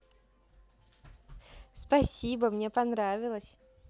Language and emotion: Russian, positive